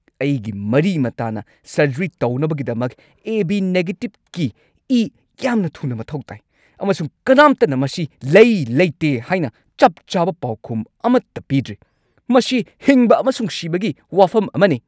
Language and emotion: Manipuri, angry